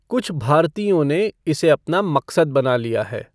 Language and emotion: Hindi, neutral